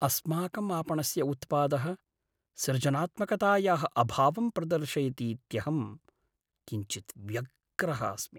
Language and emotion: Sanskrit, sad